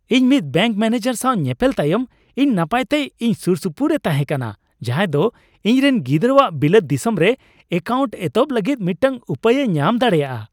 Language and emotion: Santali, happy